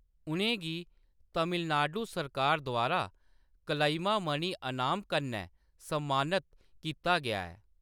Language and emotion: Dogri, neutral